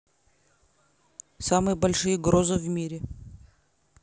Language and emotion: Russian, neutral